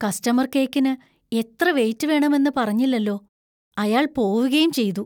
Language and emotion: Malayalam, fearful